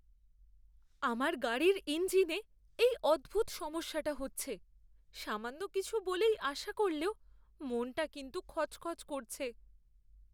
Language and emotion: Bengali, fearful